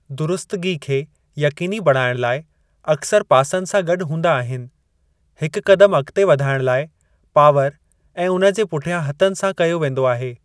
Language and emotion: Sindhi, neutral